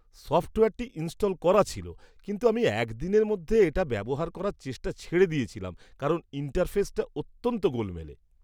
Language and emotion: Bengali, disgusted